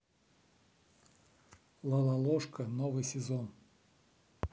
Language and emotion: Russian, neutral